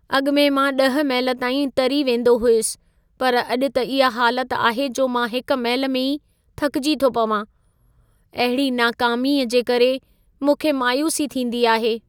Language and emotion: Sindhi, sad